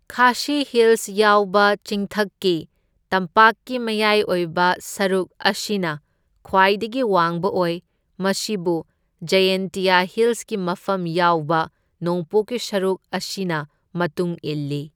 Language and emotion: Manipuri, neutral